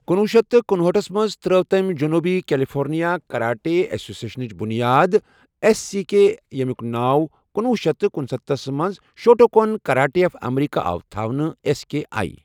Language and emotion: Kashmiri, neutral